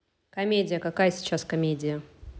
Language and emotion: Russian, neutral